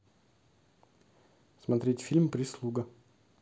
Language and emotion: Russian, neutral